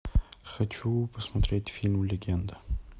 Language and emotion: Russian, neutral